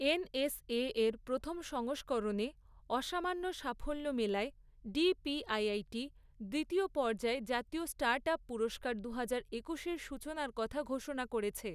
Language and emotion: Bengali, neutral